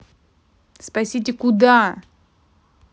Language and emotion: Russian, angry